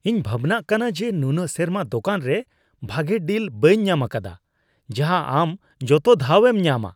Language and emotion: Santali, disgusted